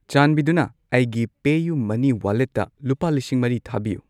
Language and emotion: Manipuri, neutral